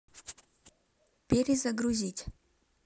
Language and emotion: Russian, neutral